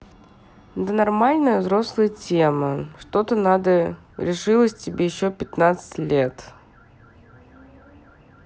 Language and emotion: Russian, neutral